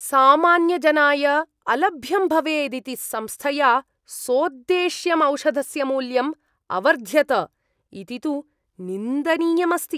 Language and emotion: Sanskrit, disgusted